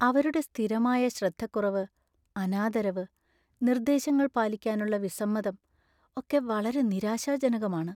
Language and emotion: Malayalam, sad